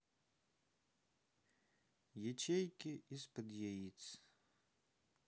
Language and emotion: Russian, sad